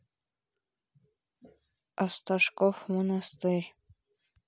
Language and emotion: Russian, neutral